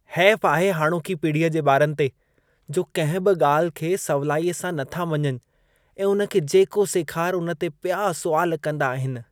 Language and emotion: Sindhi, disgusted